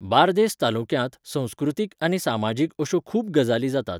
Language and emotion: Goan Konkani, neutral